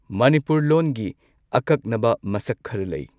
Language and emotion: Manipuri, neutral